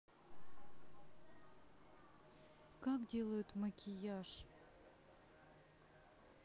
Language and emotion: Russian, sad